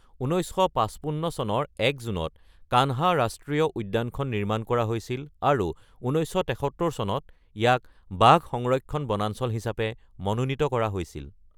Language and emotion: Assamese, neutral